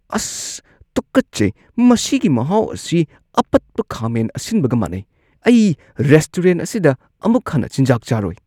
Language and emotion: Manipuri, disgusted